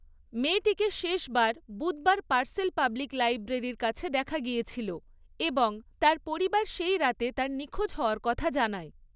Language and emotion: Bengali, neutral